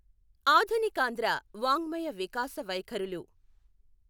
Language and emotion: Telugu, neutral